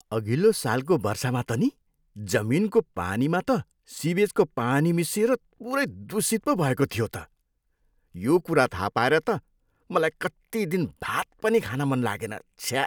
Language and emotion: Nepali, disgusted